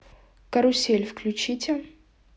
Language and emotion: Russian, neutral